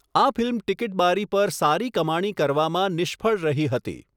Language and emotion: Gujarati, neutral